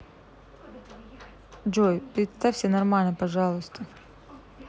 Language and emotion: Russian, neutral